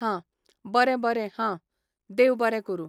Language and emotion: Goan Konkani, neutral